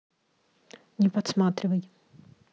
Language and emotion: Russian, neutral